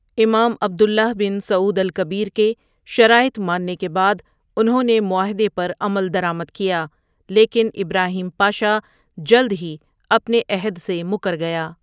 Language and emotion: Urdu, neutral